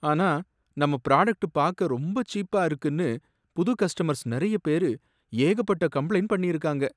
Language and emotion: Tamil, sad